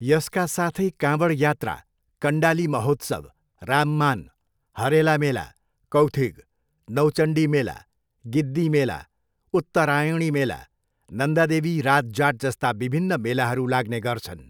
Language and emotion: Nepali, neutral